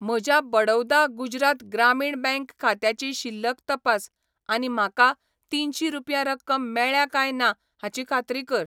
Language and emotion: Goan Konkani, neutral